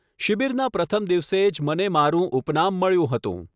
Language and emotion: Gujarati, neutral